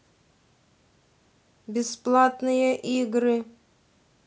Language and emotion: Russian, neutral